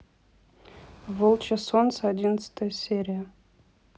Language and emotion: Russian, neutral